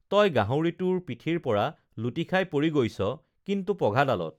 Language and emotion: Assamese, neutral